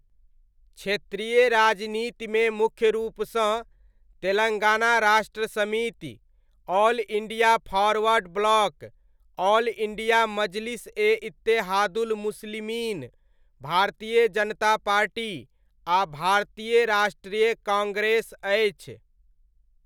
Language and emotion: Maithili, neutral